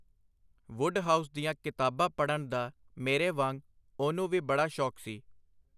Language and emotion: Punjabi, neutral